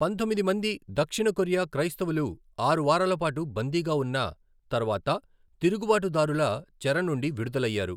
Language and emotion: Telugu, neutral